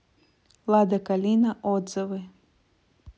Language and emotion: Russian, neutral